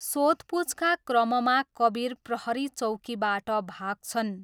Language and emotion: Nepali, neutral